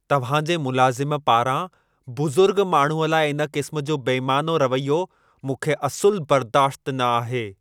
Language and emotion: Sindhi, angry